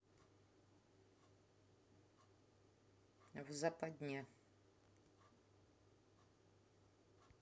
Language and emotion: Russian, neutral